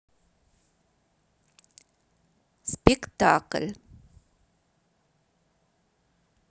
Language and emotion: Russian, neutral